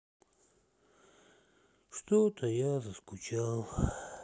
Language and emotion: Russian, sad